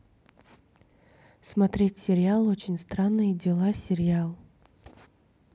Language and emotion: Russian, neutral